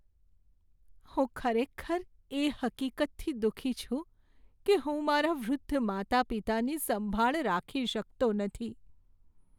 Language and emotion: Gujarati, sad